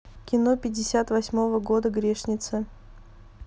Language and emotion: Russian, neutral